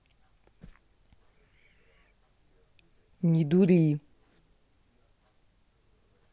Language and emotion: Russian, angry